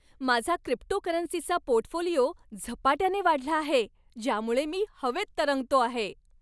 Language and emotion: Marathi, happy